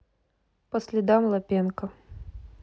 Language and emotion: Russian, neutral